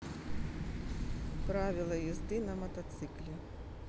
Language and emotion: Russian, neutral